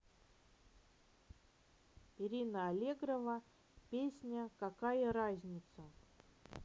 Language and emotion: Russian, neutral